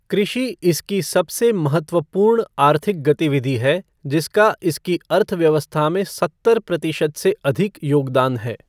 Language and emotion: Hindi, neutral